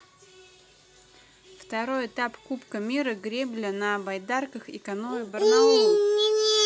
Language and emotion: Russian, neutral